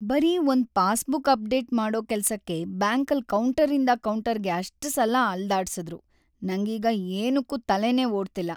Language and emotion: Kannada, sad